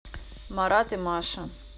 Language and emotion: Russian, neutral